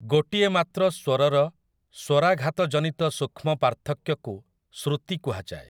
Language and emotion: Odia, neutral